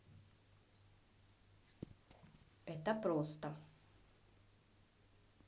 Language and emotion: Russian, neutral